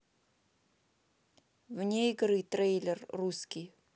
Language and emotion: Russian, neutral